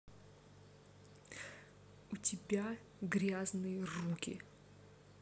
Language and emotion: Russian, angry